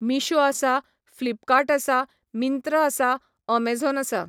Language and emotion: Goan Konkani, neutral